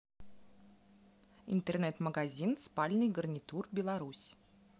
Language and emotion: Russian, neutral